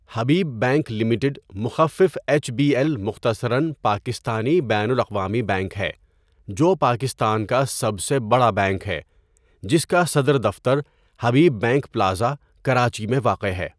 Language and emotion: Urdu, neutral